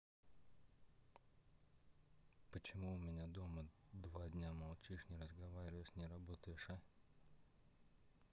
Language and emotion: Russian, neutral